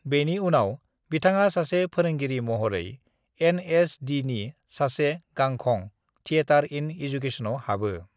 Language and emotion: Bodo, neutral